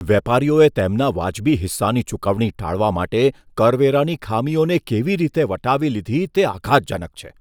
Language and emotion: Gujarati, disgusted